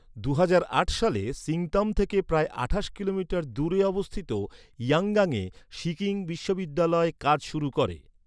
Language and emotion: Bengali, neutral